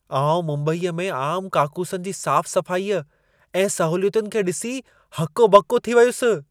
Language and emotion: Sindhi, surprised